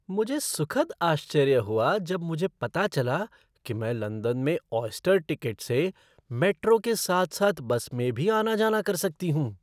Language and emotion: Hindi, surprised